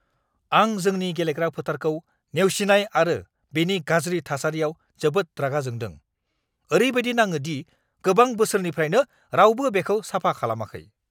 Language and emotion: Bodo, angry